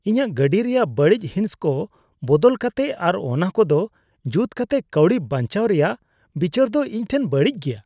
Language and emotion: Santali, disgusted